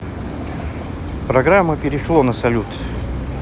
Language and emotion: Russian, neutral